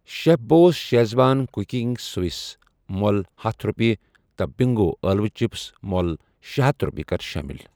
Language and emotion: Kashmiri, neutral